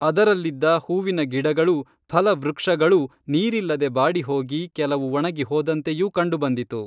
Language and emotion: Kannada, neutral